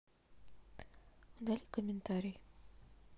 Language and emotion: Russian, sad